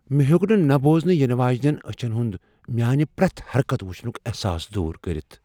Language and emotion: Kashmiri, fearful